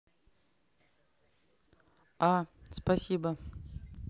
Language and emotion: Russian, neutral